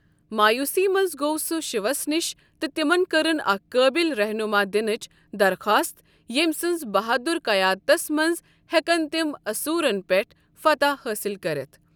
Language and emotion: Kashmiri, neutral